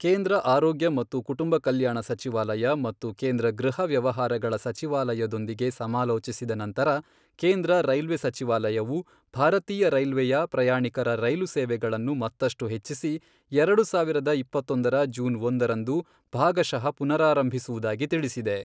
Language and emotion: Kannada, neutral